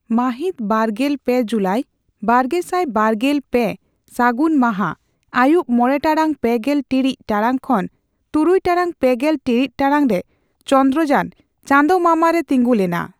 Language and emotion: Santali, neutral